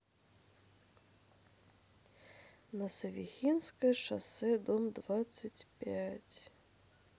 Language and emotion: Russian, sad